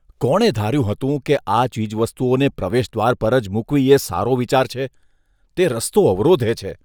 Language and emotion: Gujarati, disgusted